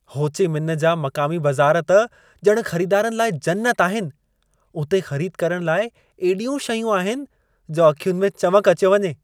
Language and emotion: Sindhi, happy